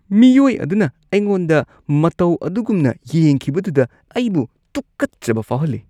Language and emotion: Manipuri, disgusted